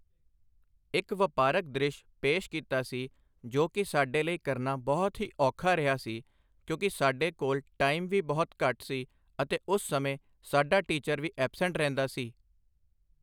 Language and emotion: Punjabi, neutral